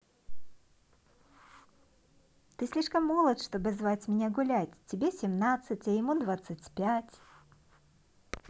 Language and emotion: Russian, positive